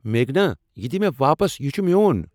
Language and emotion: Kashmiri, angry